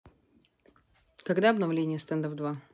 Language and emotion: Russian, neutral